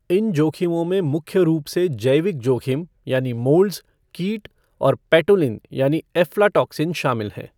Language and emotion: Hindi, neutral